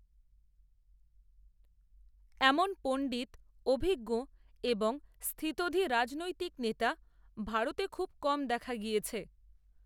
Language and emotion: Bengali, neutral